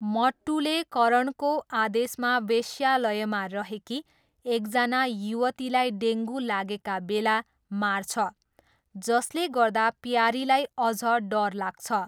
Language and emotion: Nepali, neutral